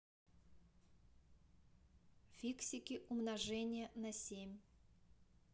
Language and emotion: Russian, neutral